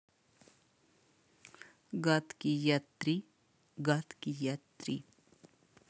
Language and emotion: Russian, neutral